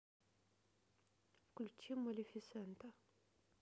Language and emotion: Russian, neutral